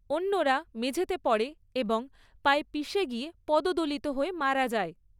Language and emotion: Bengali, neutral